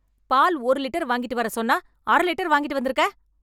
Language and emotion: Tamil, angry